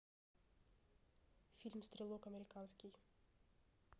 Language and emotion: Russian, neutral